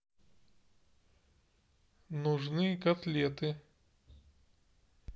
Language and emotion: Russian, neutral